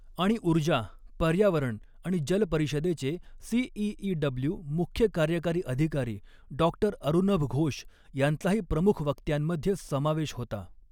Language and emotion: Marathi, neutral